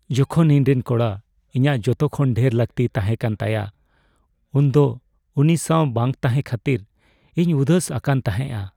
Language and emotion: Santali, sad